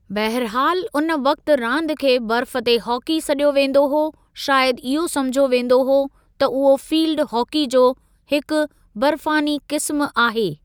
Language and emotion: Sindhi, neutral